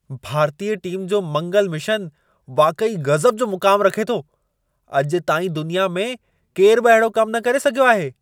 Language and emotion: Sindhi, surprised